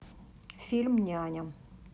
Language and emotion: Russian, neutral